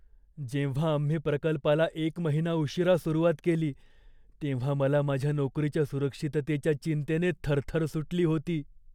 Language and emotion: Marathi, fearful